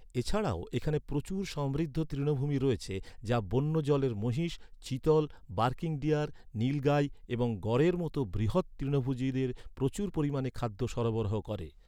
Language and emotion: Bengali, neutral